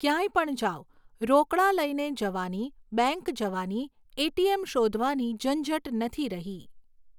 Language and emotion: Gujarati, neutral